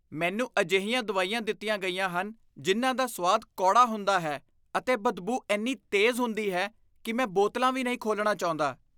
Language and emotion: Punjabi, disgusted